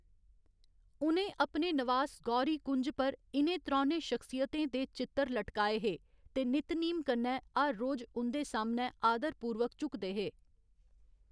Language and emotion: Dogri, neutral